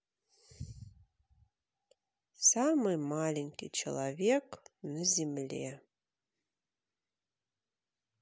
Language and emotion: Russian, neutral